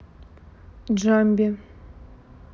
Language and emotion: Russian, neutral